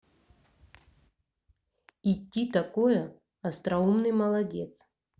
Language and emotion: Russian, neutral